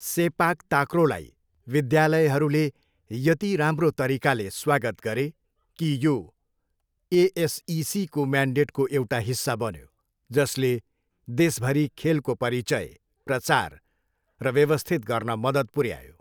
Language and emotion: Nepali, neutral